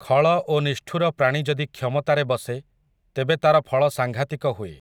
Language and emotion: Odia, neutral